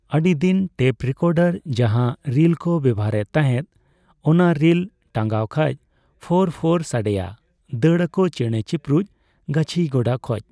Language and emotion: Santali, neutral